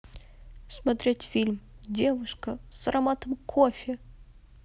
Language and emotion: Russian, sad